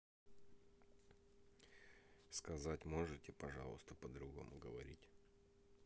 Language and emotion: Russian, neutral